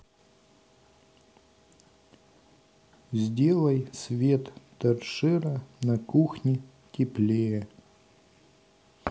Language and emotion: Russian, neutral